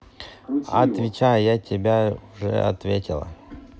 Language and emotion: Russian, neutral